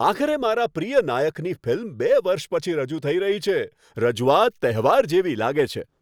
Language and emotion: Gujarati, happy